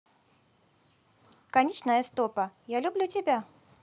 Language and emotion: Russian, positive